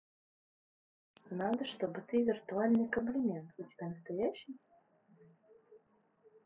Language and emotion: Russian, neutral